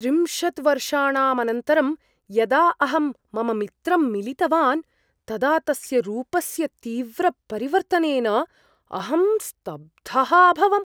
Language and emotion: Sanskrit, surprised